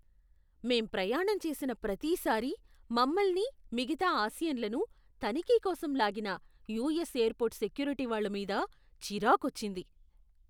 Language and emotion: Telugu, disgusted